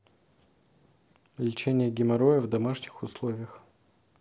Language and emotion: Russian, neutral